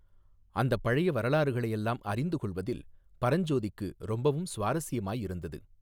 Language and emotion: Tamil, neutral